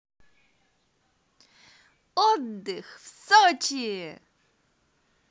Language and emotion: Russian, positive